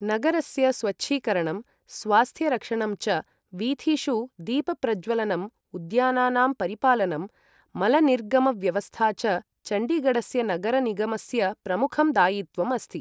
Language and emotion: Sanskrit, neutral